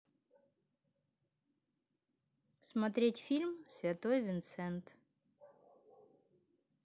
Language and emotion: Russian, neutral